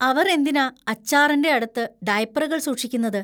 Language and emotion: Malayalam, disgusted